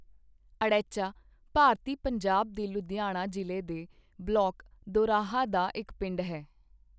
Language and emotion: Punjabi, neutral